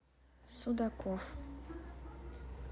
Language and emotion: Russian, sad